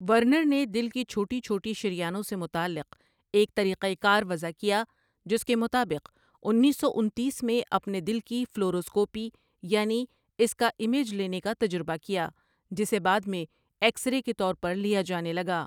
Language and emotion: Urdu, neutral